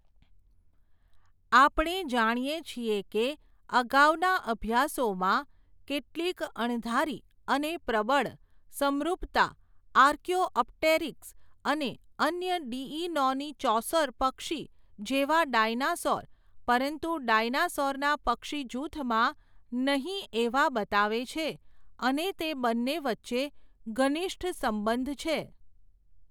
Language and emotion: Gujarati, neutral